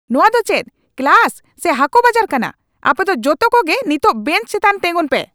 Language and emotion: Santali, angry